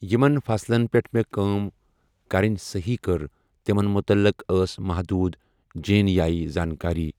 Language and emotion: Kashmiri, neutral